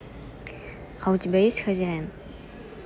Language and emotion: Russian, neutral